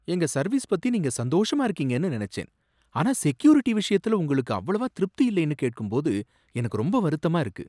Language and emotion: Tamil, surprised